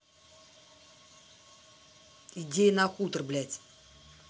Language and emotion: Russian, angry